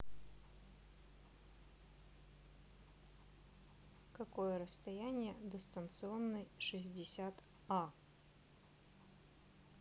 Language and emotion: Russian, neutral